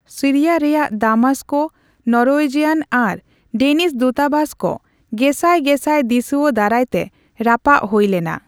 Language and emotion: Santali, neutral